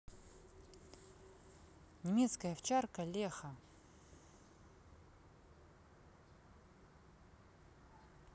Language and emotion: Russian, neutral